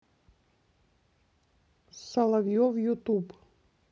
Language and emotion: Russian, neutral